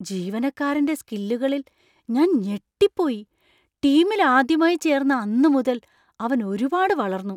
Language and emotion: Malayalam, surprised